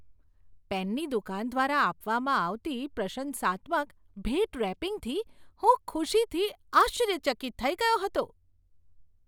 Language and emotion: Gujarati, surprised